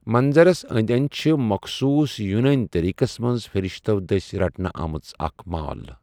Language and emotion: Kashmiri, neutral